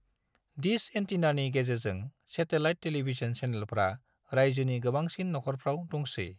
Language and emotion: Bodo, neutral